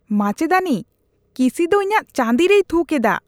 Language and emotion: Santali, disgusted